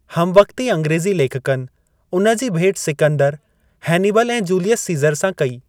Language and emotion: Sindhi, neutral